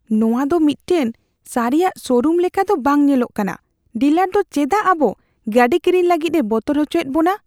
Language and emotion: Santali, fearful